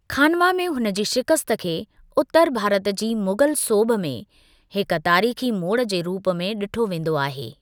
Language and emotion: Sindhi, neutral